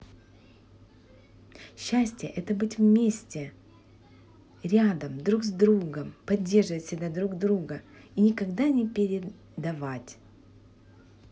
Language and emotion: Russian, positive